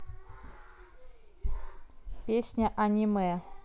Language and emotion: Russian, neutral